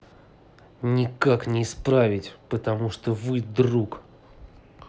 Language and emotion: Russian, angry